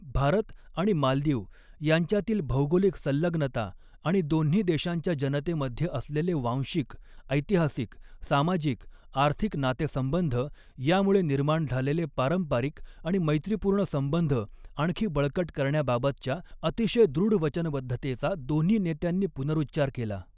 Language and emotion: Marathi, neutral